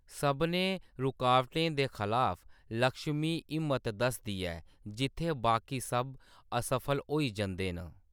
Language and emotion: Dogri, neutral